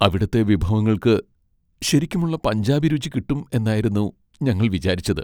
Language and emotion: Malayalam, sad